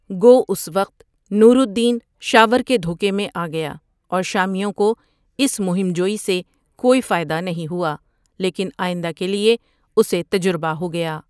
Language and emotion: Urdu, neutral